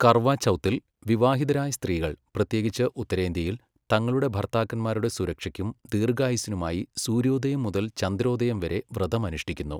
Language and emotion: Malayalam, neutral